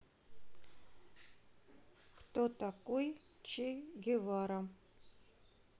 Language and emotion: Russian, neutral